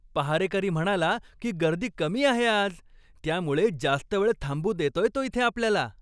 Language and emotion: Marathi, happy